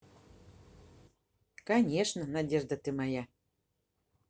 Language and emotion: Russian, positive